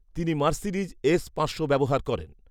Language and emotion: Bengali, neutral